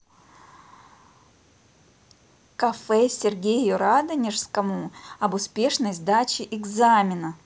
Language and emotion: Russian, positive